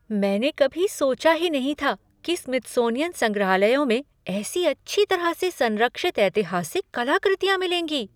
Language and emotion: Hindi, surprised